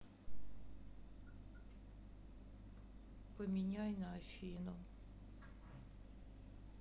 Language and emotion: Russian, sad